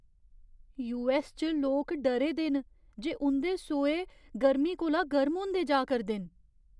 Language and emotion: Dogri, fearful